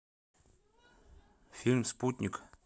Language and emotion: Russian, neutral